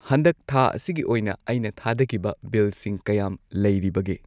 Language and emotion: Manipuri, neutral